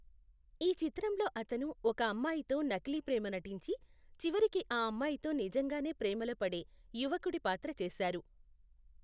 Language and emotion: Telugu, neutral